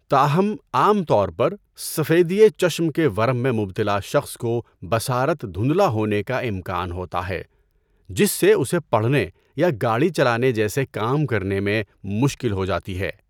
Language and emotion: Urdu, neutral